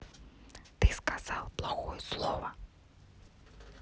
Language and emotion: Russian, neutral